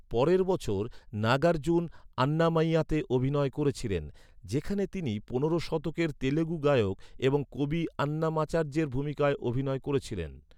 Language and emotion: Bengali, neutral